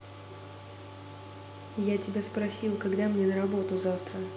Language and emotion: Russian, neutral